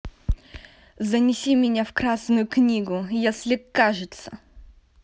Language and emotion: Russian, angry